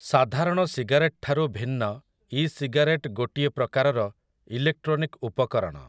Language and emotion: Odia, neutral